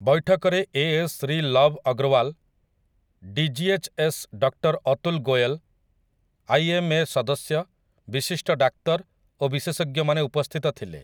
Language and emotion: Odia, neutral